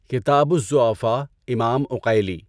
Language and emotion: Urdu, neutral